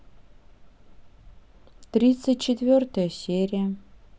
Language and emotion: Russian, neutral